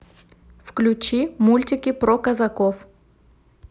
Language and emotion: Russian, neutral